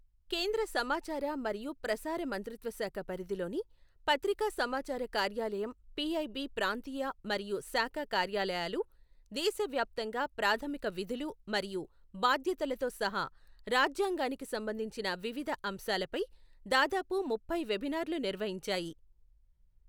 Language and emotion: Telugu, neutral